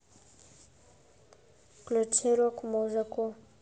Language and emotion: Russian, neutral